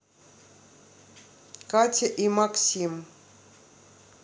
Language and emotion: Russian, neutral